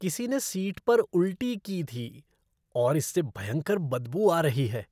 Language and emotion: Hindi, disgusted